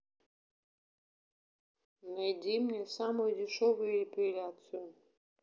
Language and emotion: Russian, neutral